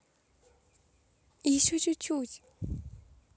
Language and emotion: Russian, positive